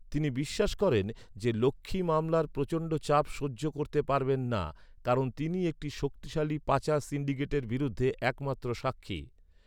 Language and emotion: Bengali, neutral